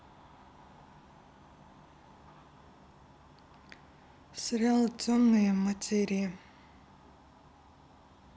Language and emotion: Russian, neutral